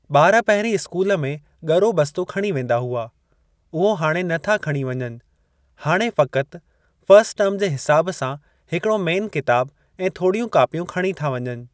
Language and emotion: Sindhi, neutral